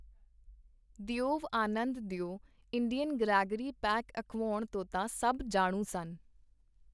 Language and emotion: Punjabi, neutral